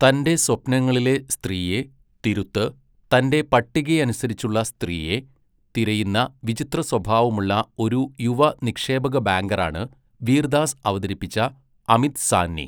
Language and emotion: Malayalam, neutral